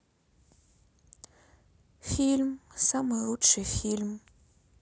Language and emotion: Russian, sad